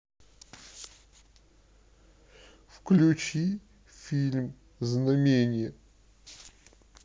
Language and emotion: Russian, sad